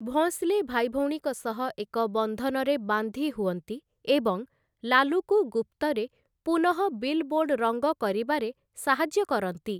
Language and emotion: Odia, neutral